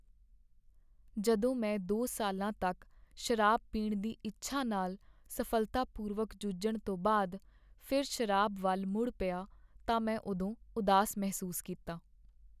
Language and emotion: Punjabi, sad